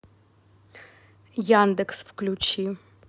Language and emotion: Russian, neutral